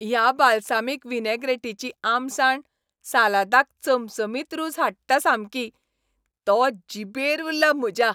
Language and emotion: Goan Konkani, happy